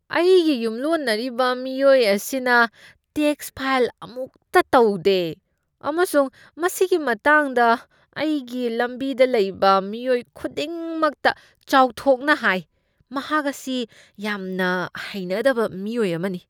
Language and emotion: Manipuri, disgusted